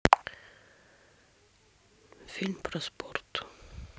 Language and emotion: Russian, neutral